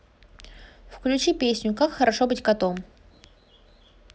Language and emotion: Russian, neutral